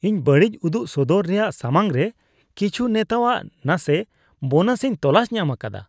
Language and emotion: Santali, disgusted